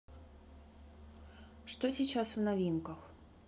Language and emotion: Russian, neutral